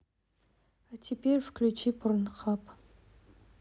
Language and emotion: Russian, neutral